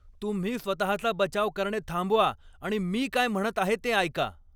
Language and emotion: Marathi, angry